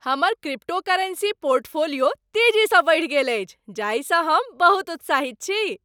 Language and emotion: Maithili, happy